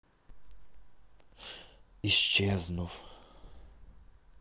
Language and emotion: Russian, sad